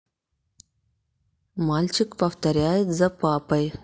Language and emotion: Russian, neutral